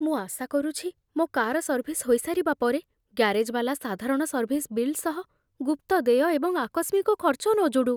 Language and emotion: Odia, fearful